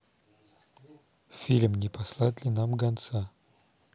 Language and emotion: Russian, neutral